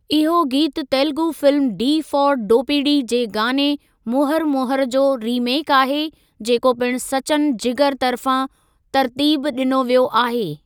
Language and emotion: Sindhi, neutral